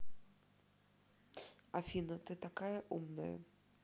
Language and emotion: Russian, neutral